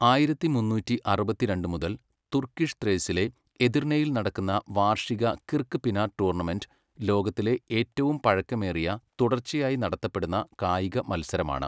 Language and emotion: Malayalam, neutral